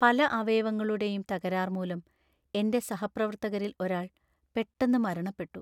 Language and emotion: Malayalam, sad